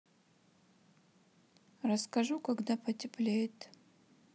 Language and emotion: Russian, sad